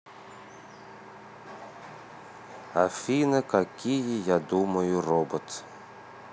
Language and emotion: Russian, neutral